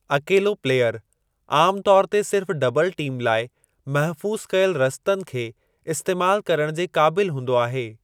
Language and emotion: Sindhi, neutral